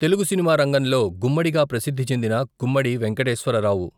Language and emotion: Telugu, neutral